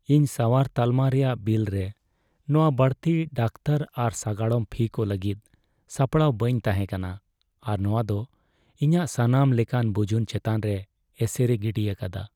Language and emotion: Santali, sad